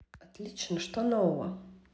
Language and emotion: Russian, neutral